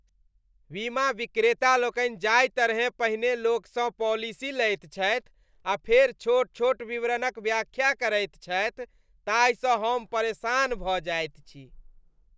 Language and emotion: Maithili, disgusted